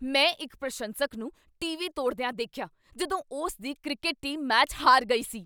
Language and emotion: Punjabi, angry